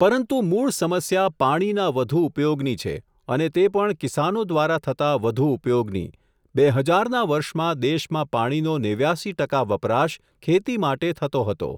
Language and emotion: Gujarati, neutral